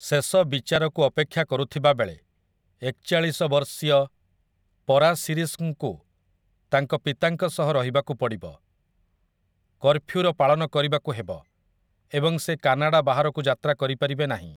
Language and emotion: Odia, neutral